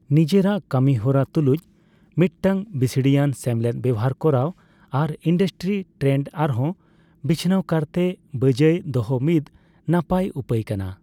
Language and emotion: Santali, neutral